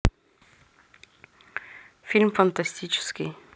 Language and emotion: Russian, neutral